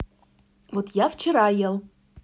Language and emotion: Russian, neutral